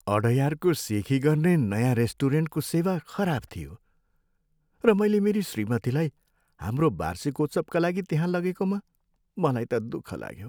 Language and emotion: Nepali, sad